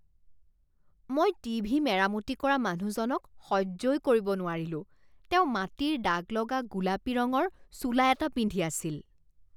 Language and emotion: Assamese, disgusted